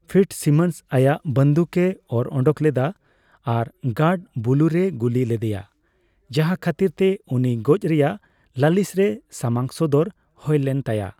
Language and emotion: Santali, neutral